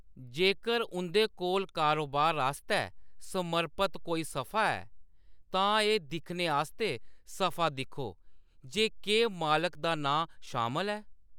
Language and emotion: Dogri, neutral